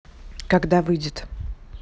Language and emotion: Russian, neutral